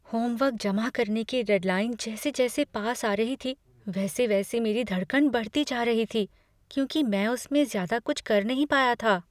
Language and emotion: Hindi, fearful